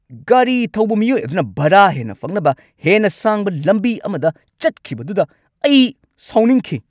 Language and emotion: Manipuri, angry